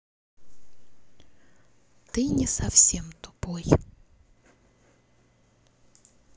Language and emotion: Russian, neutral